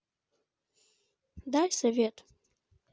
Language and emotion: Russian, neutral